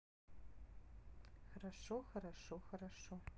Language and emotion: Russian, neutral